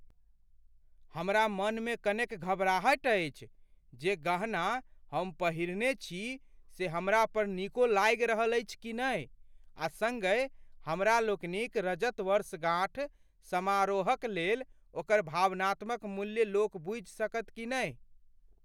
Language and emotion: Maithili, fearful